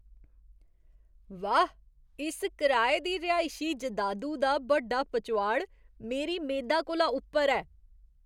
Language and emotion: Dogri, surprised